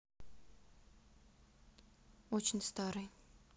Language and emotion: Russian, sad